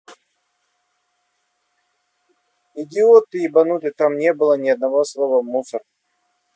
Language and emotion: Russian, angry